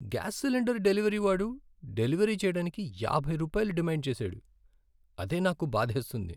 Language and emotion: Telugu, sad